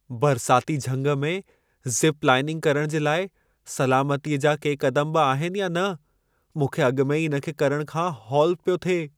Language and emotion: Sindhi, fearful